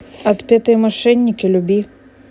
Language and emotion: Russian, neutral